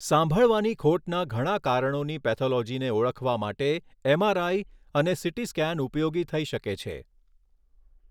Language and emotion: Gujarati, neutral